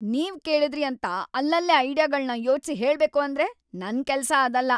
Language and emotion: Kannada, angry